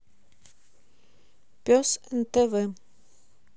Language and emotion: Russian, neutral